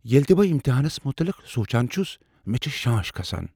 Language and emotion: Kashmiri, fearful